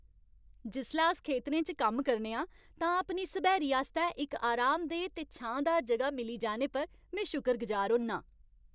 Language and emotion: Dogri, happy